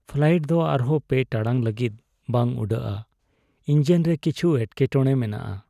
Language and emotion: Santali, sad